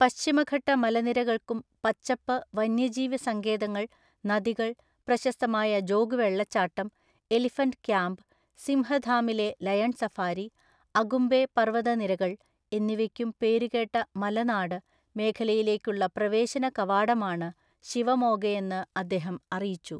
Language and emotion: Malayalam, neutral